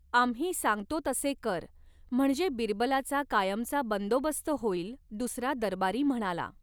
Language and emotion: Marathi, neutral